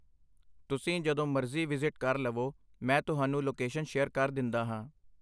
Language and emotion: Punjabi, neutral